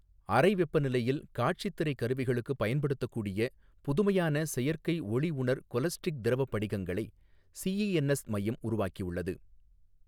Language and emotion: Tamil, neutral